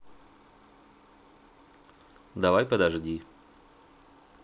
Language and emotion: Russian, neutral